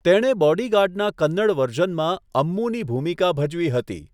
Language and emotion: Gujarati, neutral